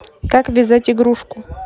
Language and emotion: Russian, neutral